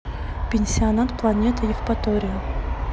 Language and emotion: Russian, neutral